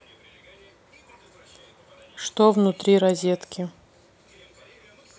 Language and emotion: Russian, neutral